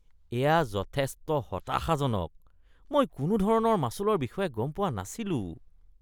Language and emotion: Assamese, disgusted